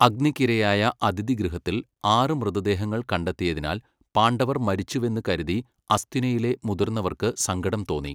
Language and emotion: Malayalam, neutral